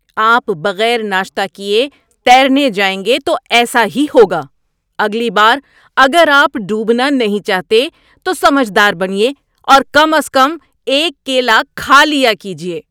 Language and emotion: Urdu, angry